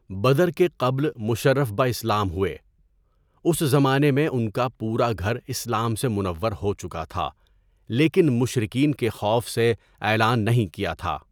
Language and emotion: Urdu, neutral